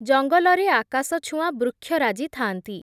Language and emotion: Odia, neutral